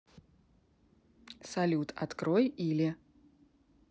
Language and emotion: Russian, neutral